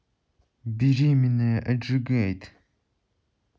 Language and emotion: Russian, neutral